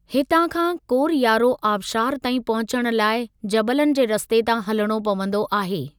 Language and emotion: Sindhi, neutral